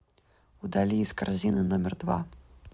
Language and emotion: Russian, neutral